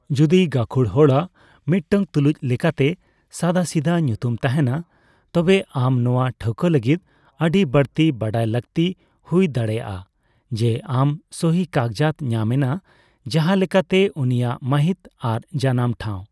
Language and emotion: Santali, neutral